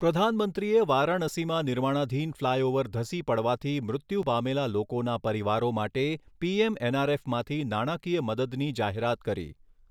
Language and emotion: Gujarati, neutral